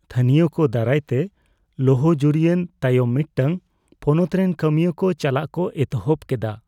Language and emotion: Santali, fearful